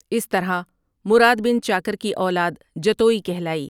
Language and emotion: Urdu, neutral